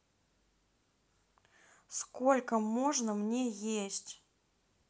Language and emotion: Russian, angry